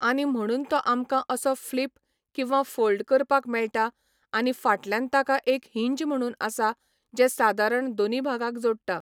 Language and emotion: Goan Konkani, neutral